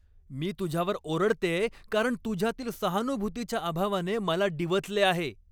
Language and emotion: Marathi, angry